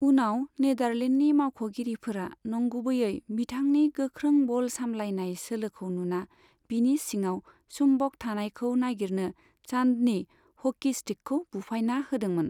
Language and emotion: Bodo, neutral